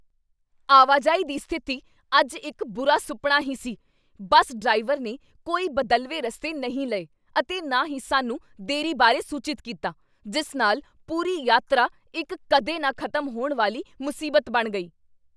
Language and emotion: Punjabi, angry